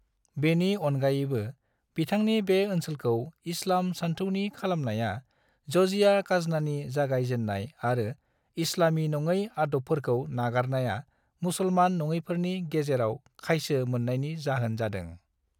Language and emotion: Bodo, neutral